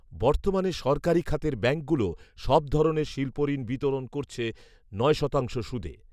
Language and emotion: Bengali, neutral